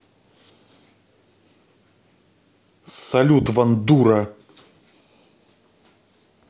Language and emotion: Russian, angry